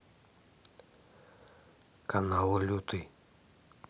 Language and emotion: Russian, neutral